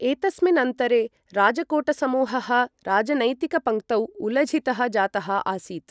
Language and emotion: Sanskrit, neutral